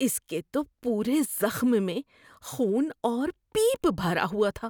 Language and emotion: Urdu, disgusted